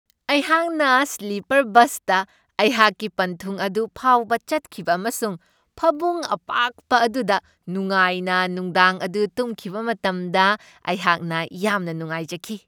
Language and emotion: Manipuri, happy